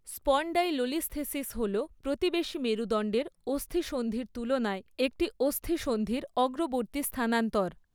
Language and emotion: Bengali, neutral